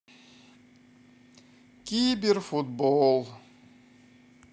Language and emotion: Russian, sad